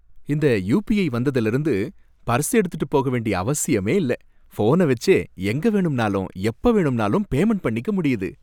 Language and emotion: Tamil, happy